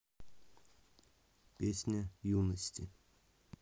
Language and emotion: Russian, neutral